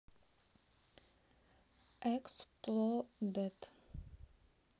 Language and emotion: Russian, neutral